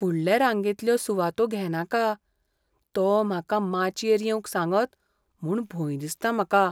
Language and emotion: Goan Konkani, fearful